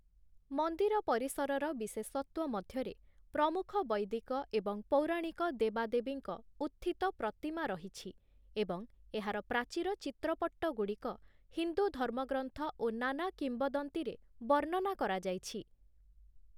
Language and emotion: Odia, neutral